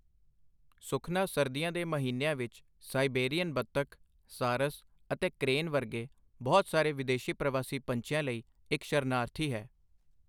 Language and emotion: Punjabi, neutral